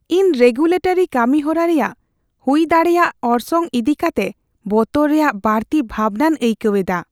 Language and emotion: Santali, fearful